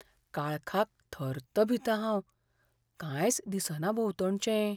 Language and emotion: Goan Konkani, fearful